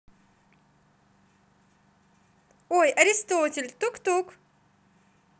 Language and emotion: Russian, neutral